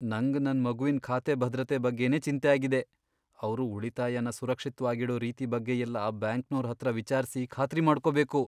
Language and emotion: Kannada, fearful